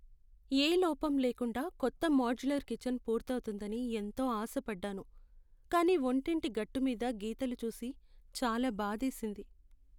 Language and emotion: Telugu, sad